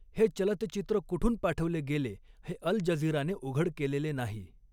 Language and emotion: Marathi, neutral